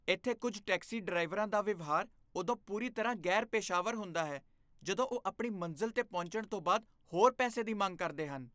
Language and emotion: Punjabi, disgusted